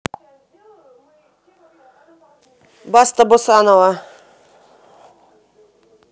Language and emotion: Russian, neutral